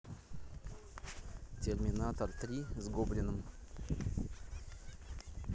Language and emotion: Russian, neutral